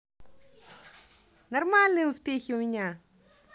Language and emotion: Russian, positive